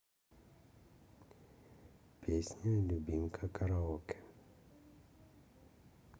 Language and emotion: Russian, neutral